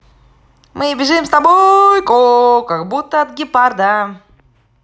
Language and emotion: Russian, positive